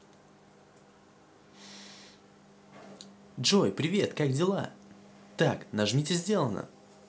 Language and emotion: Russian, positive